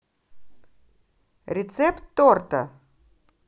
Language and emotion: Russian, positive